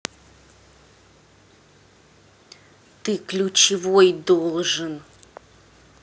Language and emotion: Russian, angry